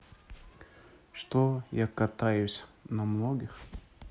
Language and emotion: Russian, neutral